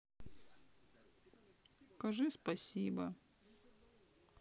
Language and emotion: Russian, sad